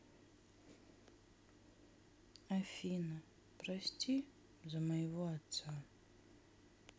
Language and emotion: Russian, sad